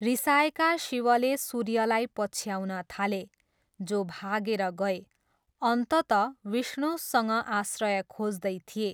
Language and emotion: Nepali, neutral